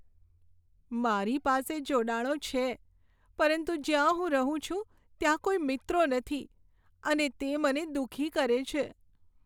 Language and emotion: Gujarati, sad